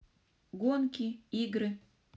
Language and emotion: Russian, neutral